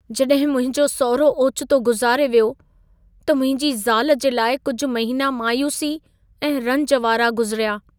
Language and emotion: Sindhi, sad